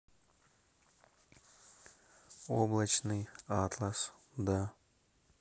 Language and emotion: Russian, neutral